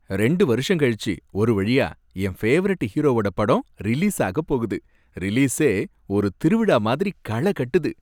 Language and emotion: Tamil, happy